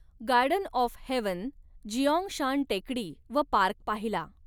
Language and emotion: Marathi, neutral